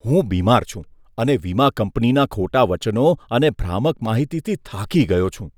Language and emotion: Gujarati, disgusted